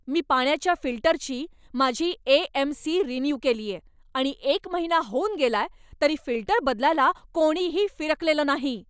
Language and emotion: Marathi, angry